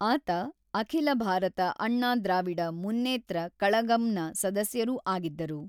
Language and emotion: Kannada, neutral